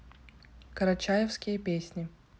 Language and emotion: Russian, neutral